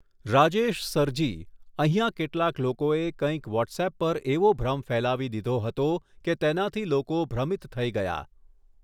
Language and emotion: Gujarati, neutral